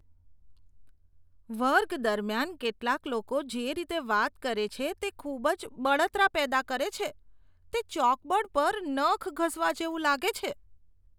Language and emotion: Gujarati, disgusted